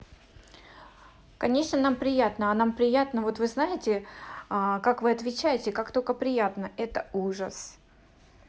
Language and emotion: Russian, neutral